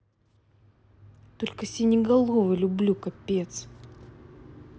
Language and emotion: Russian, angry